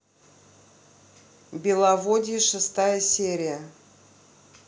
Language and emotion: Russian, neutral